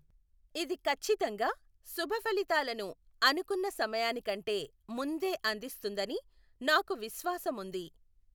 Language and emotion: Telugu, neutral